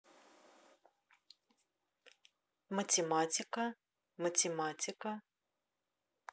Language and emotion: Russian, neutral